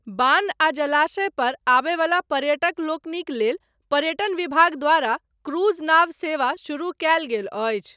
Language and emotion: Maithili, neutral